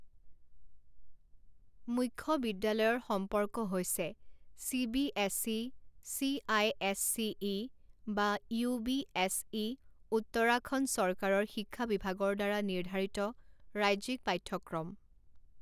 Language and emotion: Assamese, neutral